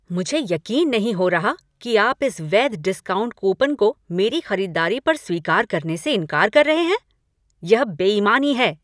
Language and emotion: Hindi, angry